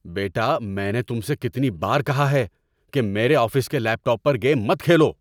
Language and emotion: Urdu, angry